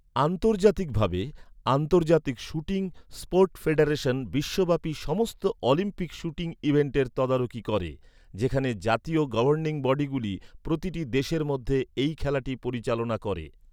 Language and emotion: Bengali, neutral